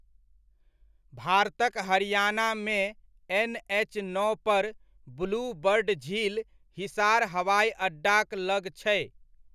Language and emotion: Maithili, neutral